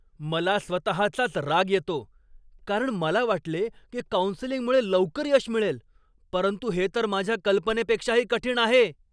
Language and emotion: Marathi, angry